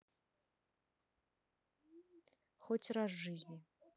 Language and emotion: Russian, neutral